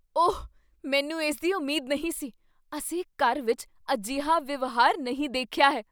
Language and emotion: Punjabi, surprised